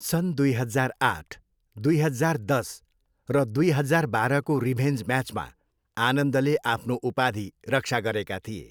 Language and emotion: Nepali, neutral